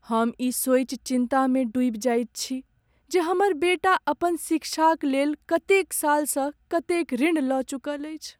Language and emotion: Maithili, sad